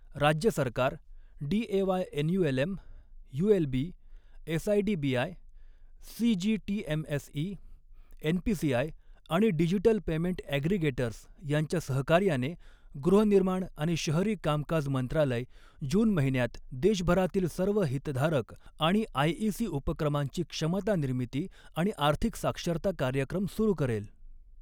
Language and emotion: Marathi, neutral